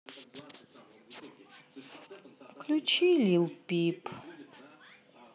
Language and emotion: Russian, sad